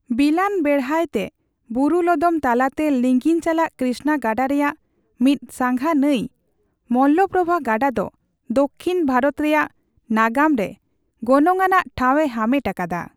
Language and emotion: Santali, neutral